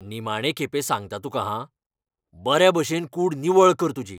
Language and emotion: Goan Konkani, angry